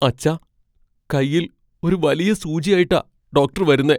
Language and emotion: Malayalam, fearful